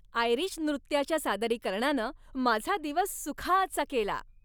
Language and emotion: Marathi, happy